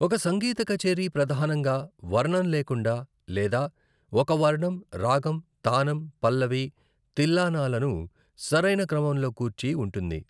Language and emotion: Telugu, neutral